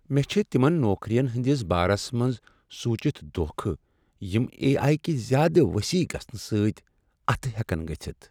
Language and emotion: Kashmiri, sad